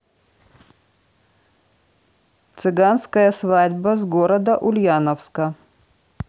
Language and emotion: Russian, neutral